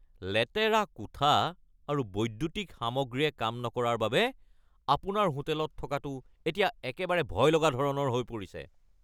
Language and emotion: Assamese, angry